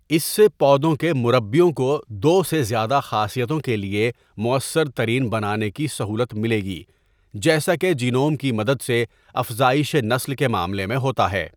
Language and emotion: Urdu, neutral